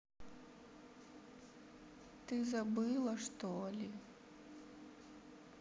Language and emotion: Russian, sad